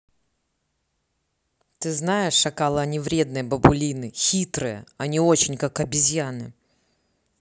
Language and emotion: Russian, neutral